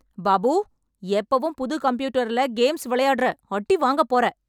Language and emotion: Tamil, angry